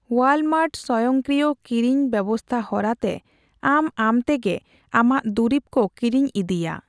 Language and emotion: Santali, neutral